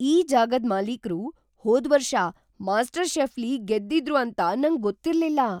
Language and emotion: Kannada, surprised